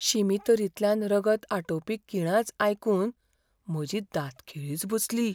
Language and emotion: Goan Konkani, fearful